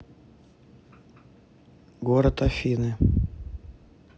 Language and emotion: Russian, neutral